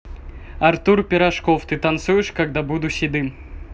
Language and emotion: Russian, neutral